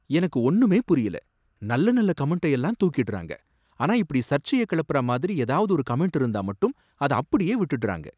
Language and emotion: Tamil, surprised